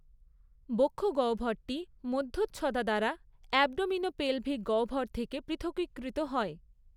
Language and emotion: Bengali, neutral